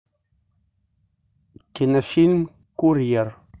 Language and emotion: Russian, neutral